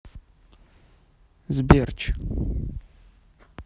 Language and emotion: Russian, neutral